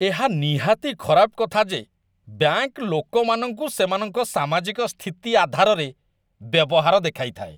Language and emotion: Odia, disgusted